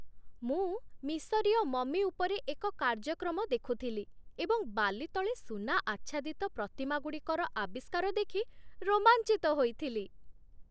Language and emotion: Odia, happy